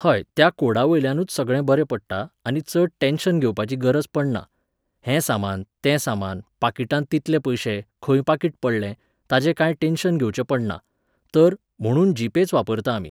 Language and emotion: Goan Konkani, neutral